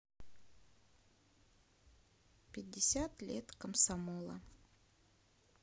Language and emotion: Russian, neutral